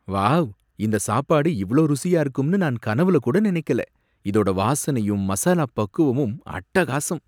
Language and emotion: Tamil, surprised